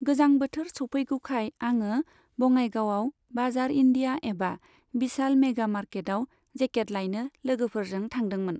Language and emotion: Bodo, neutral